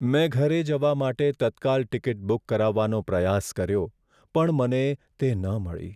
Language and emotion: Gujarati, sad